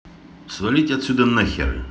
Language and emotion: Russian, angry